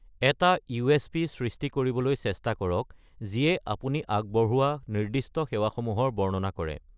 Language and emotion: Assamese, neutral